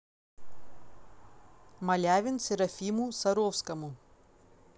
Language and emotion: Russian, neutral